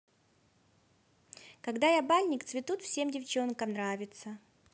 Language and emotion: Russian, positive